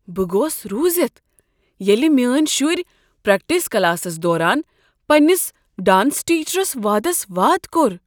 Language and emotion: Kashmiri, surprised